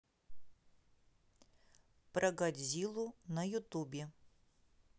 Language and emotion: Russian, neutral